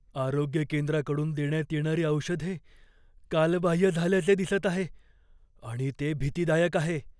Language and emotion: Marathi, fearful